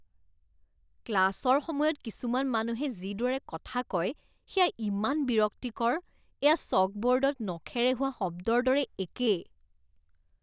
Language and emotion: Assamese, disgusted